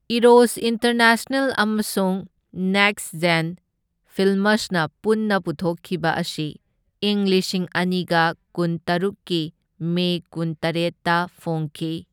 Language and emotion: Manipuri, neutral